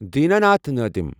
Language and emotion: Kashmiri, neutral